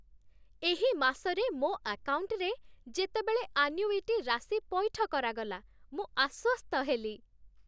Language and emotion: Odia, happy